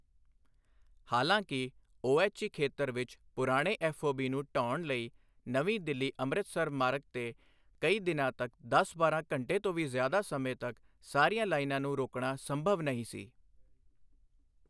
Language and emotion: Punjabi, neutral